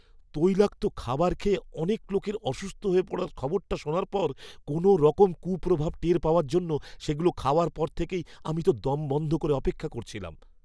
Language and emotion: Bengali, fearful